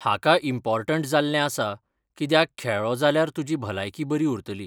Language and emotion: Goan Konkani, neutral